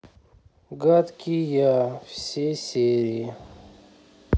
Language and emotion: Russian, sad